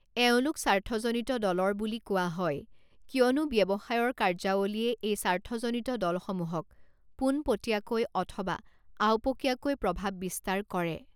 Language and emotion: Assamese, neutral